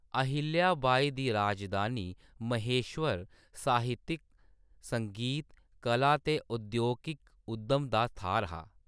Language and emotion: Dogri, neutral